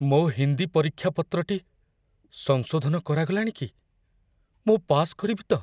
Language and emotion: Odia, fearful